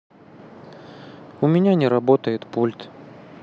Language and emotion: Russian, sad